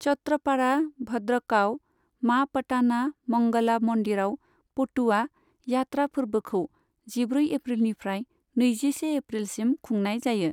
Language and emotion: Bodo, neutral